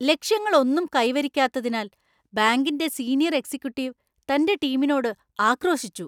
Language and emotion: Malayalam, angry